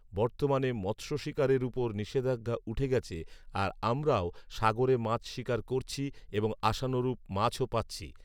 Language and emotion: Bengali, neutral